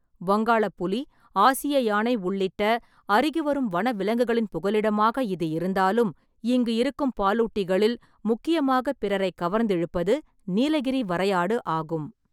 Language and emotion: Tamil, neutral